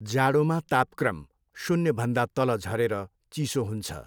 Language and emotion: Nepali, neutral